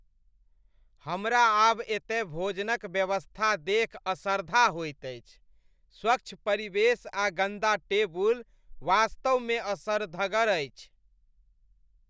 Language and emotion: Maithili, disgusted